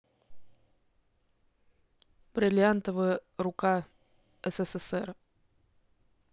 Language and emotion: Russian, neutral